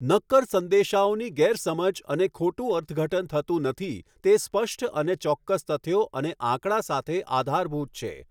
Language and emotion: Gujarati, neutral